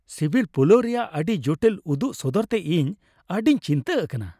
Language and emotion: Santali, happy